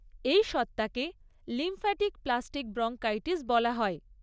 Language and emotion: Bengali, neutral